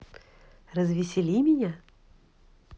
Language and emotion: Russian, positive